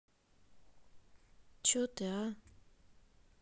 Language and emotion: Russian, angry